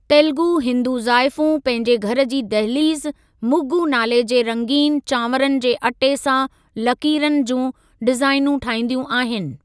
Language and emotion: Sindhi, neutral